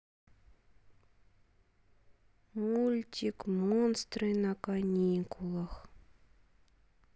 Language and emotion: Russian, sad